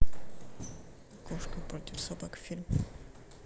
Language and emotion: Russian, neutral